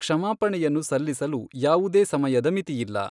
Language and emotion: Kannada, neutral